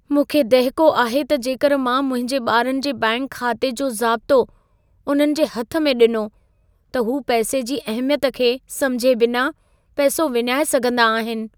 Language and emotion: Sindhi, fearful